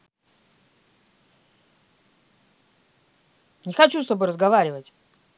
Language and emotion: Russian, angry